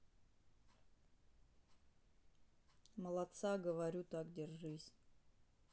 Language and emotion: Russian, neutral